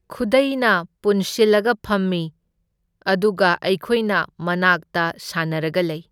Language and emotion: Manipuri, neutral